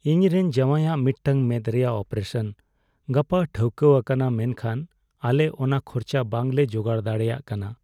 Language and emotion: Santali, sad